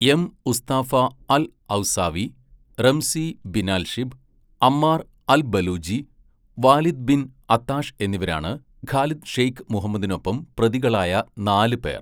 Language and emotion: Malayalam, neutral